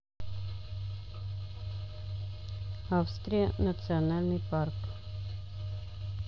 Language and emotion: Russian, neutral